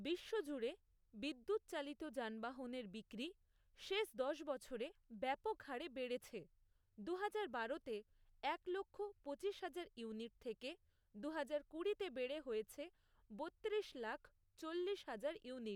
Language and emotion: Bengali, neutral